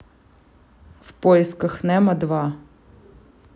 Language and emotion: Russian, neutral